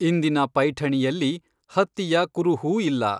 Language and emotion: Kannada, neutral